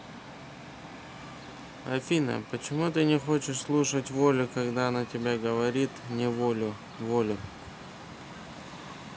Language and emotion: Russian, neutral